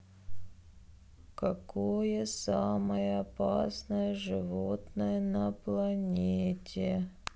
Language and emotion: Russian, sad